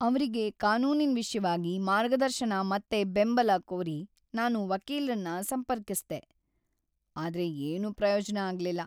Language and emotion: Kannada, sad